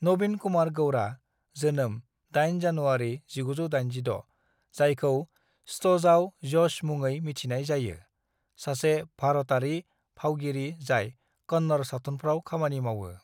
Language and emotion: Bodo, neutral